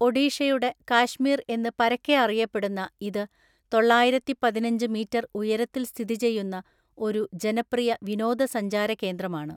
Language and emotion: Malayalam, neutral